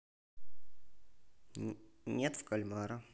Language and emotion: Russian, neutral